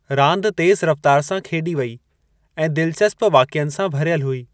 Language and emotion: Sindhi, neutral